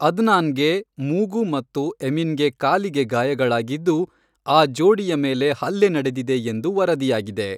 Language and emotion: Kannada, neutral